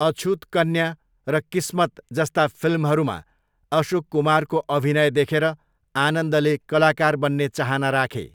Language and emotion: Nepali, neutral